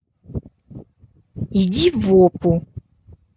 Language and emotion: Russian, angry